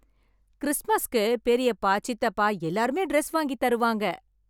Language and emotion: Tamil, happy